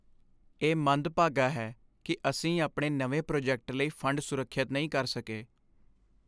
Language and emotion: Punjabi, sad